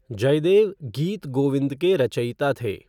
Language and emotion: Hindi, neutral